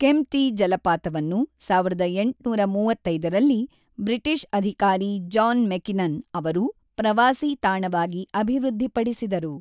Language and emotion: Kannada, neutral